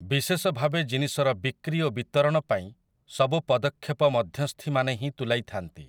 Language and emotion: Odia, neutral